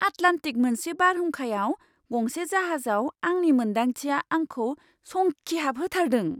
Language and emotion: Bodo, surprised